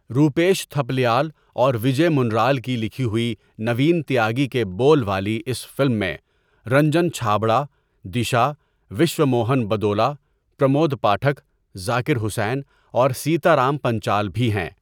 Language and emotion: Urdu, neutral